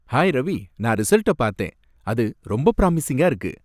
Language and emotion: Tamil, happy